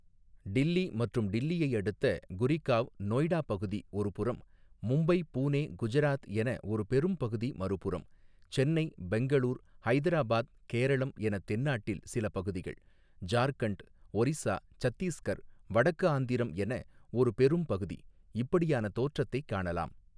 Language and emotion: Tamil, neutral